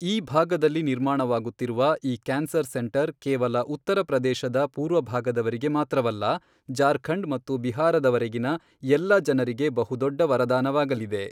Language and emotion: Kannada, neutral